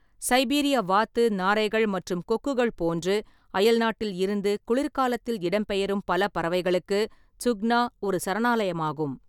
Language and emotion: Tamil, neutral